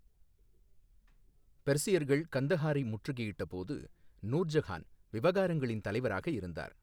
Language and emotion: Tamil, neutral